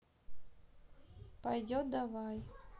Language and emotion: Russian, neutral